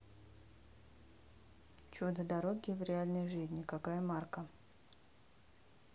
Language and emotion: Russian, neutral